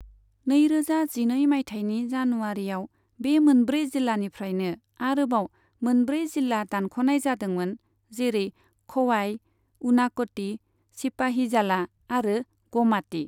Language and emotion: Bodo, neutral